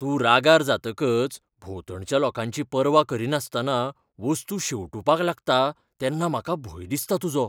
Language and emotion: Goan Konkani, fearful